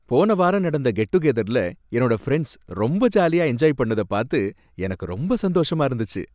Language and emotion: Tamil, happy